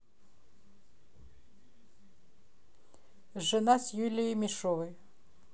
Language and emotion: Russian, neutral